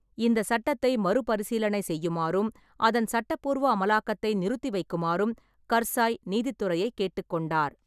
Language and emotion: Tamil, neutral